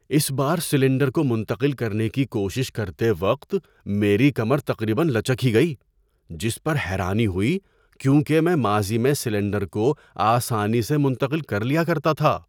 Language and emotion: Urdu, surprised